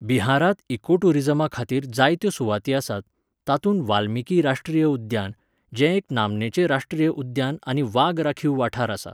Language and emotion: Goan Konkani, neutral